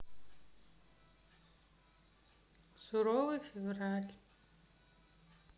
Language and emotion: Russian, neutral